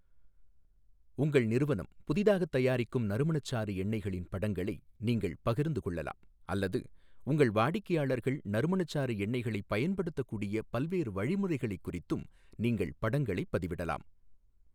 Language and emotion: Tamil, neutral